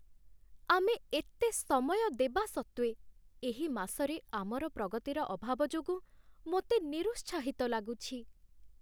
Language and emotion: Odia, sad